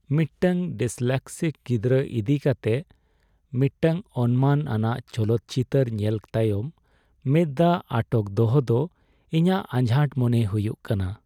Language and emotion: Santali, sad